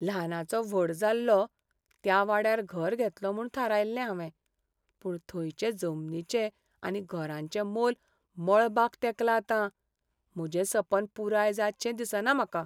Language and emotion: Goan Konkani, sad